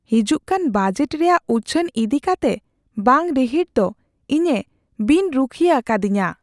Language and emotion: Santali, fearful